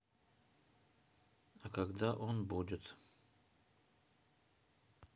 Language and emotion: Russian, neutral